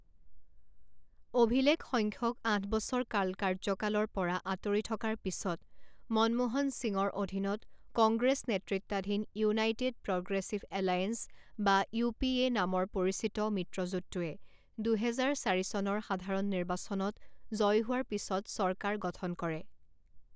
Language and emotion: Assamese, neutral